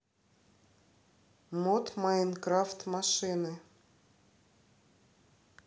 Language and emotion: Russian, neutral